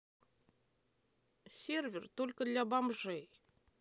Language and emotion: Russian, neutral